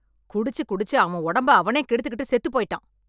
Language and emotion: Tamil, angry